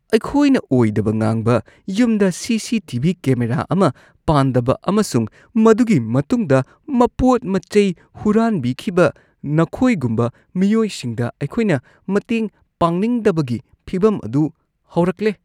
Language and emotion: Manipuri, disgusted